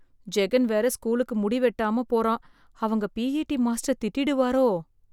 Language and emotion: Tamil, fearful